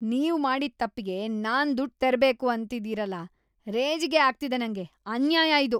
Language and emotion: Kannada, disgusted